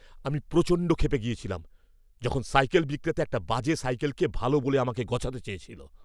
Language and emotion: Bengali, angry